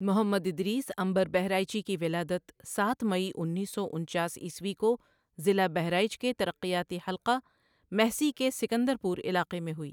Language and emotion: Urdu, neutral